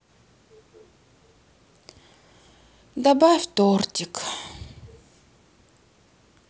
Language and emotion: Russian, sad